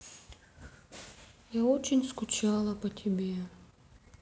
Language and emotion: Russian, sad